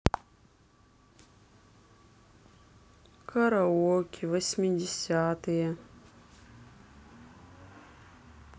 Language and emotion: Russian, sad